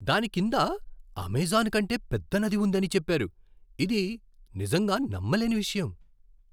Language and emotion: Telugu, surprised